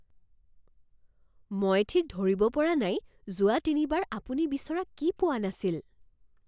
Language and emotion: Assamese, surprised